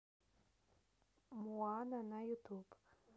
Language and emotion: Russian, neutral